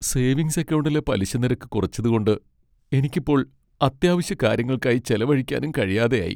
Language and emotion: Malayalam, sad